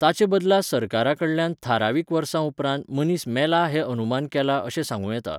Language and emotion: Goan Konkani, neutral